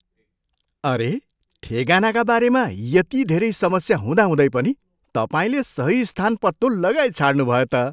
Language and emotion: Nepali, surprised